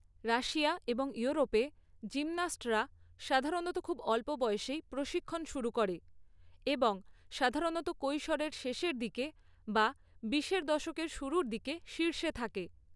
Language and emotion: Bengali, neutral